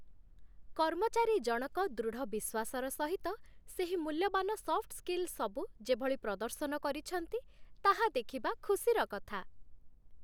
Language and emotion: Odia, happy